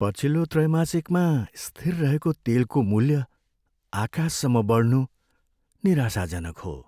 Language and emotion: Nepali, sad